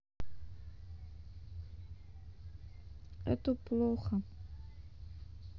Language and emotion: Russian, sad